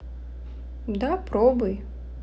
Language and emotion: Russian, neutral